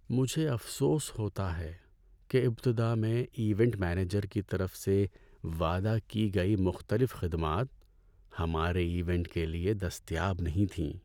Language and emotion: Urdu, sad